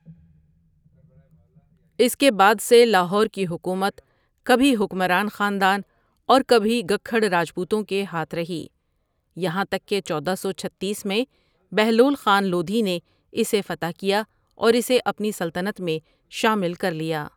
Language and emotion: Urdu, neutral